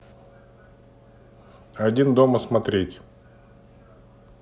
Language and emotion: Russian, neutral